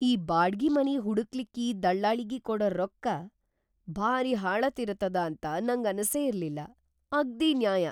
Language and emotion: Kannada, surprised